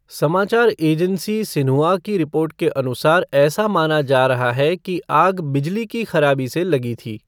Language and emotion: Hindi, neutral